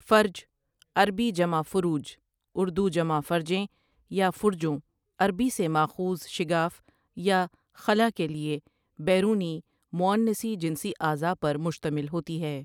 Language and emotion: Urdu, neutral